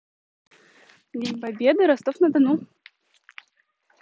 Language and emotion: Russian, neutral